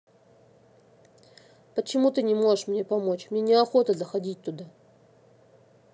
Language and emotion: Russian, neutral